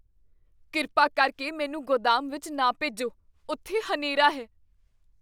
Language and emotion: Punjabi, fearful